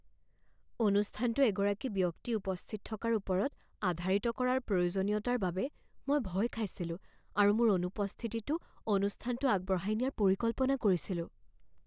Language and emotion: Assamese, fearful